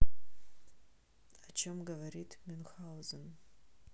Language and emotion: Russian, neutral